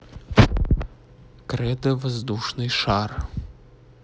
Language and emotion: Russian, neutral